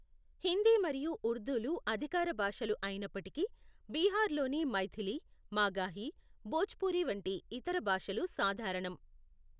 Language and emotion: Telugu, neutral